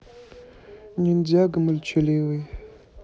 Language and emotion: Russian, neutral